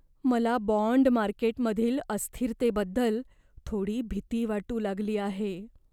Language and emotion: Marathi, fearful